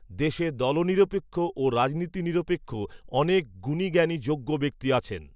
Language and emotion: Bengali, neutral